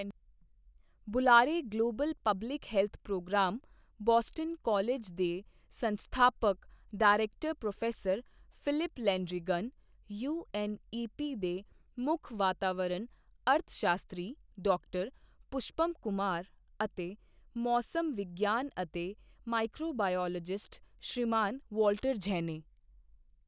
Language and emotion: Punjabi, neutral